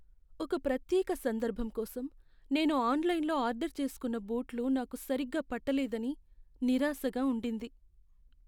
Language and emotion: Telugu, sad